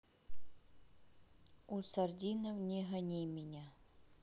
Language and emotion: Russian, neutral